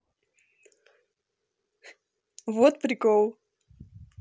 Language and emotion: Russian, positive